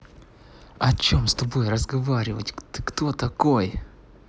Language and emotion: Russian, angry